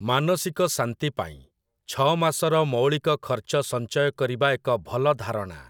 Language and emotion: Odia, neutral